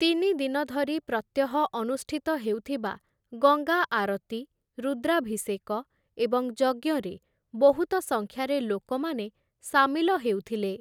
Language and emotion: Odia, neutral